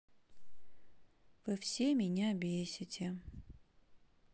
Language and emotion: Russian, sad